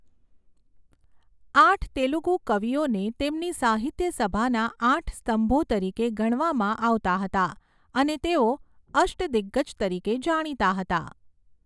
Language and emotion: Gujarati, neutral